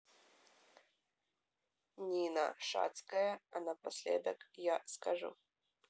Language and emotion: Russian, neutral